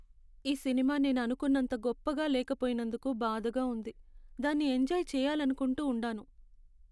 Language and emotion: Telugu, sad